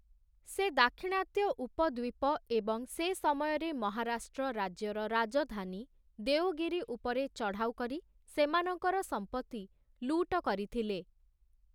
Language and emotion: Odia, neutral